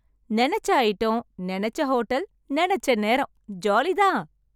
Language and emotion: Tamil, happy